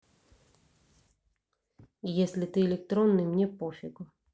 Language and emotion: Russian, neutral